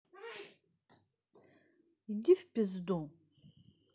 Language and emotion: Russian, neutral